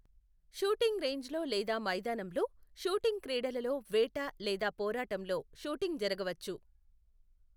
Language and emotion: Telugu, neutral